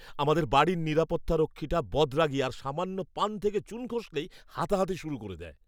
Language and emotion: Bengali, angry